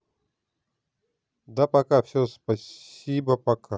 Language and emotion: Russian, neutral